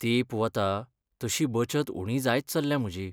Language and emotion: Goan Konkani, sad